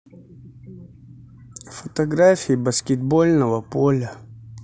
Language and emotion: Russian, neutral